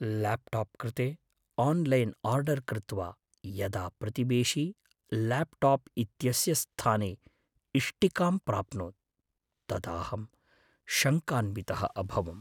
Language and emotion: Sanskrit, fearful